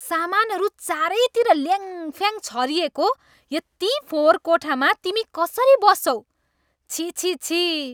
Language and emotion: Nepali, disgusted